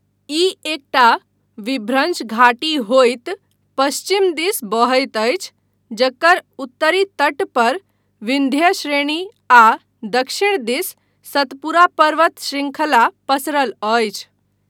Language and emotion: Maithili, neutral